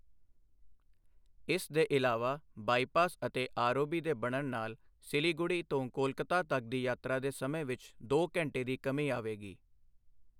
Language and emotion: Punjabi, neutral